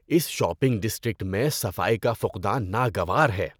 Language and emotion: Urdu, disgusted